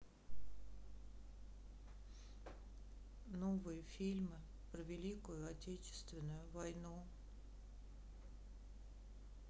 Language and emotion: Russian, sad